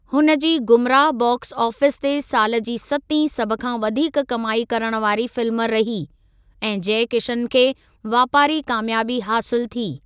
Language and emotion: Sindhi, neutral